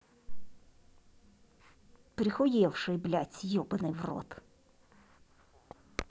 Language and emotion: Russian, angry